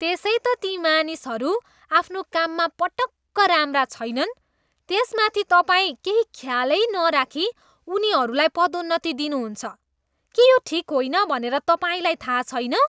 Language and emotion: Nepali, disgusted